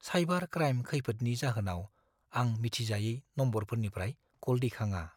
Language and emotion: Bodo, fearful